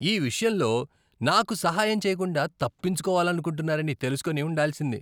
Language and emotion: Telugu, disgusted